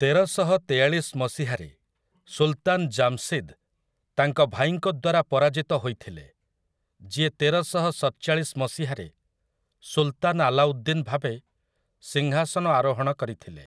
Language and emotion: Odia, neutral